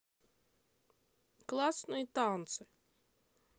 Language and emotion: Russian, neutral